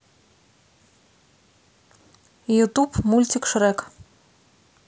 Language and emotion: Russian, neutral